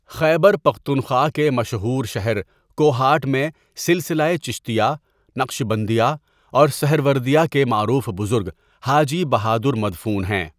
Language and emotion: Urdu, neutral